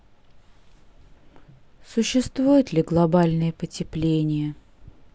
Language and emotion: Russian, sad